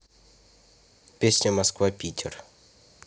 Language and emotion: Russian, neutral